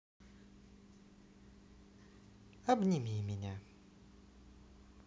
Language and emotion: Russian, neutral